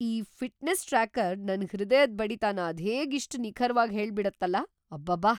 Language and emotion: Kannada, surprised